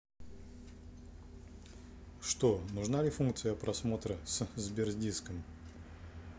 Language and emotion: Russian, neutral